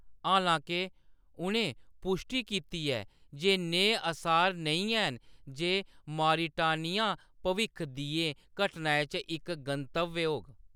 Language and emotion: Dogri, neutral